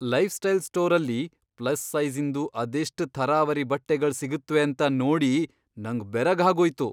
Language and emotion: Kannada, surprised